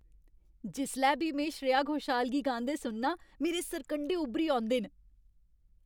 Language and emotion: Dogri, happy